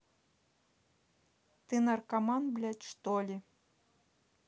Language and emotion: Russian, angry